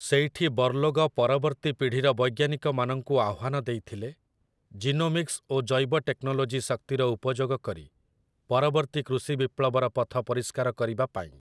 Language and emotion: Odia, neutral